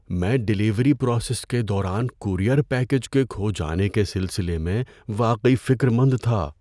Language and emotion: Urdu, fearful